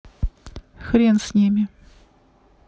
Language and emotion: Russian, neutral